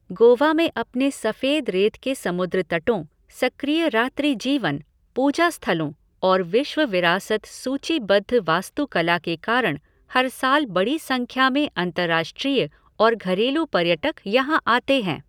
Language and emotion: Hindi, neutral